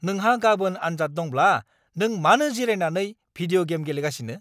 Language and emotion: Bodo, angry